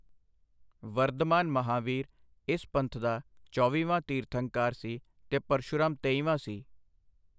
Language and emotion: Punjabi, neutral